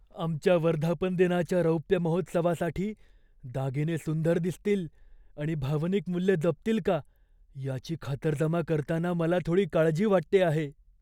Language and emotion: Marathi, fearful